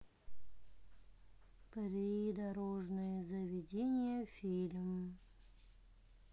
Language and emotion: Russian, neutral